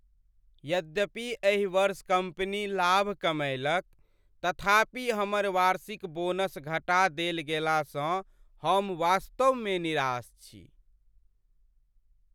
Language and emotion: Maithili, sad